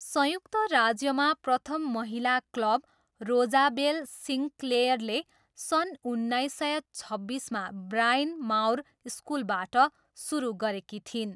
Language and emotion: Nepali, neutral